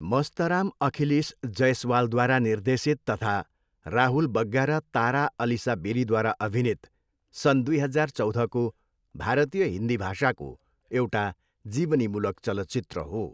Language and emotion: Nepali, neutral